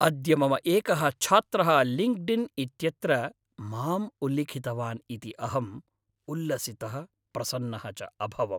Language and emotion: Sanskrit, happy